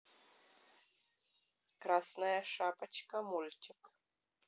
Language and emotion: Russian, neutral